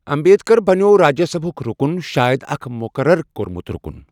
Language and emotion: Kashmiri, neutral